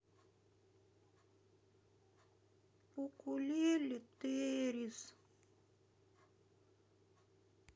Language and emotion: Russian, sad